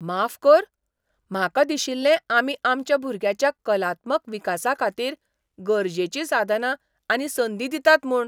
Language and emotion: Goan Konkani, surprised